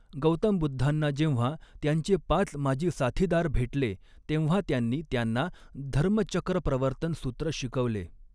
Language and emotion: Marathi, neutral